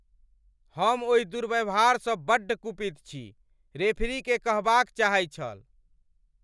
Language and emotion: Maithili, angry